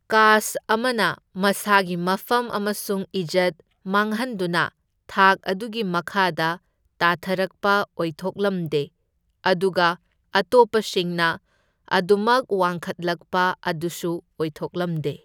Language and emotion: Manipuri, neutral